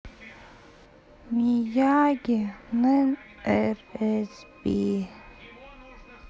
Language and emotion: Russian, sad